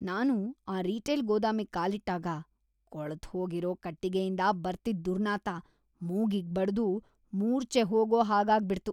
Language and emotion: Kannada, disgusted